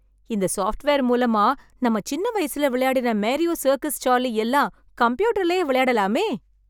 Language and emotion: Tamil, happy